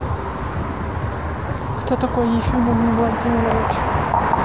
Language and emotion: Russian, neutral